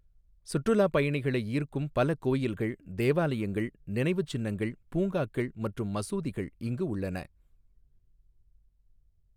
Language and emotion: Tamil, neutral